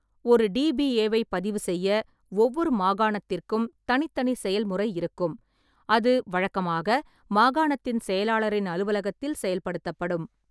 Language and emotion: Tamil, neutral